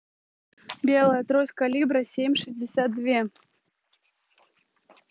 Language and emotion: Russian, neutral